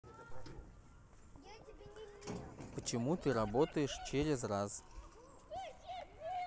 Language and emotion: Russian, neutral